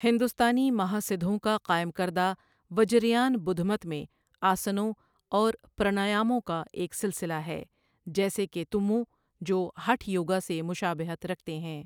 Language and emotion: Urdu, neutral